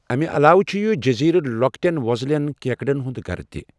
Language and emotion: Kashmiri, neutral